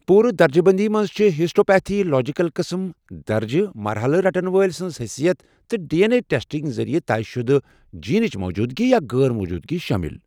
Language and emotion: Kashmiri, neutral